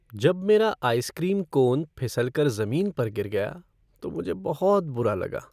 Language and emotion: Hindi, sad